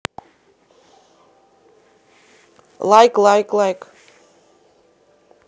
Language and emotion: Russian, neutral